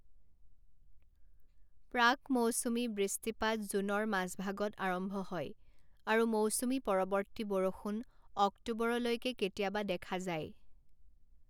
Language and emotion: Assamese, neutral